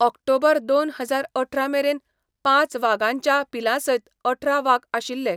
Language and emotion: Goan Konkani, neutral